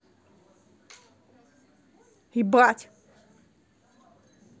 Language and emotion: Russian, angry